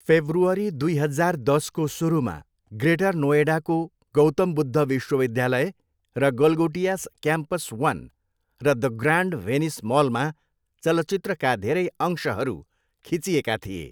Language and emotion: Nepali, neutral